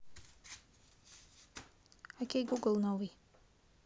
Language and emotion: Russian, neutral